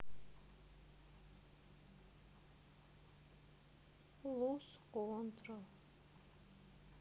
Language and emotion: Russian, sad